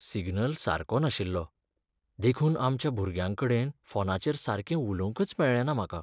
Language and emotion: Goan Konkani, sad